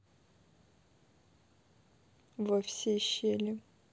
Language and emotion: Russian, neutral